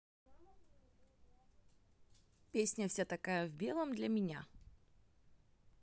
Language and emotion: Russian, neutral